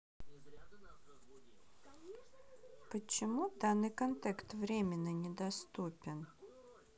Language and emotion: Russian, neutral